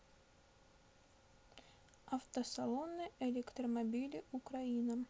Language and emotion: Russian, neutral